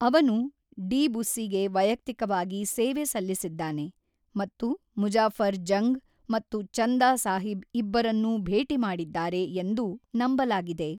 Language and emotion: Kannada, neutral